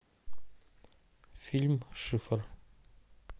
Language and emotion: Russian, neutral